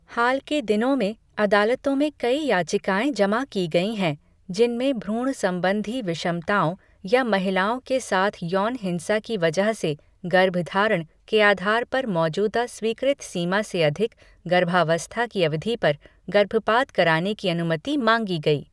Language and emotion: Hindi, neutral